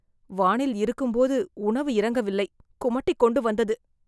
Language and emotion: Tamil, disgusted